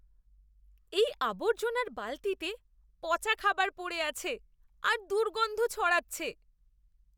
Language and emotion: Bengali, disgusted